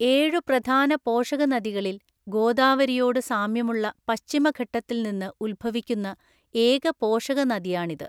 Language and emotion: Malayalam, neutral